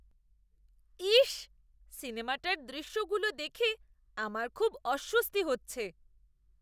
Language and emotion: Bengali, disgusted